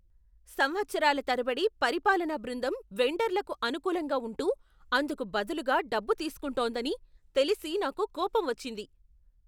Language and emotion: Telugu, angry